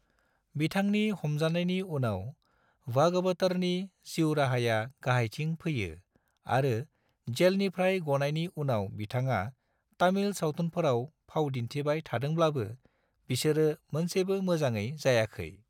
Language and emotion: Bodo, neutral